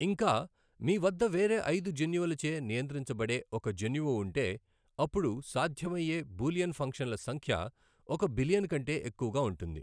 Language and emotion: Telugu, neutral